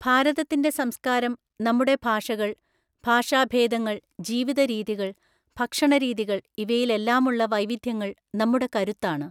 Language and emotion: Malayalam, neutral